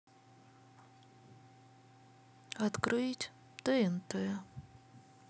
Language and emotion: Russian, sad